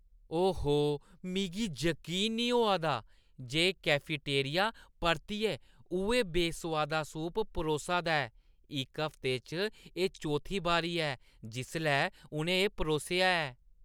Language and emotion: Dogri, disgusted